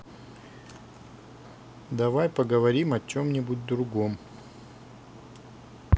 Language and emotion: Russian, neutral